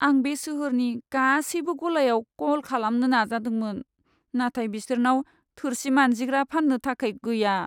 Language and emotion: Bodo, sad